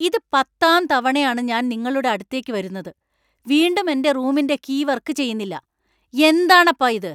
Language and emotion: Malayalam, angry